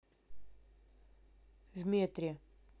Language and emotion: Russian, neutral